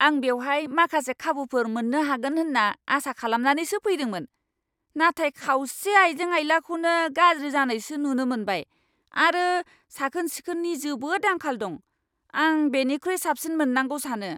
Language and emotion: Bodo, angry